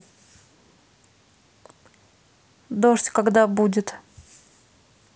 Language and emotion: Russian, neutral